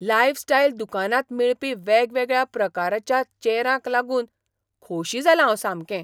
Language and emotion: Goan Konkani, surprised